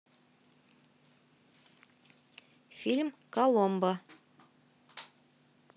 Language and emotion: Russian, neutral